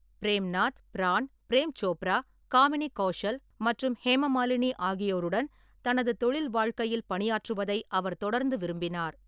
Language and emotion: Tamil, neutral